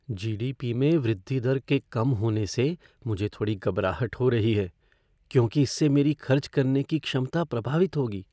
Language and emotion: Hindi, fearful